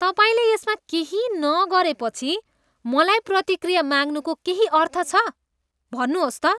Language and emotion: Nepali, disgusted